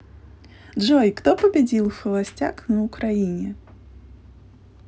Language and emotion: Russian, positive